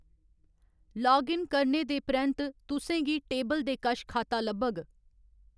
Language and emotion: Dogri, neutral